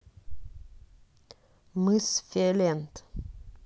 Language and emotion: Russian, neutral